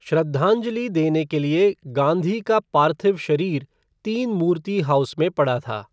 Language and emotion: Hindi, neutral